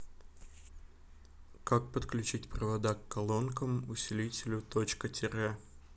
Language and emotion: Russian, neutral